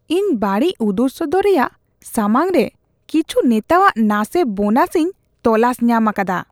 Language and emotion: Santali, disgusted